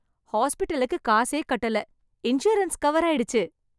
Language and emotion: Tamil, happy